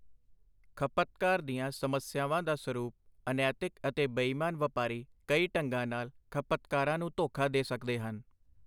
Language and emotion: Punjabi, neutral